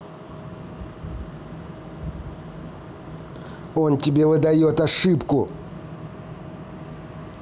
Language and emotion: Russian, angry